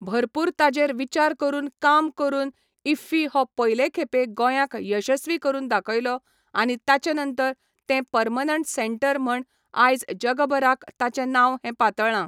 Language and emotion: Goan Konkani, neutral